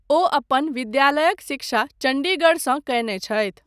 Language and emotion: Maithili, neutral